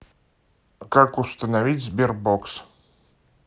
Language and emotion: Russian, neutral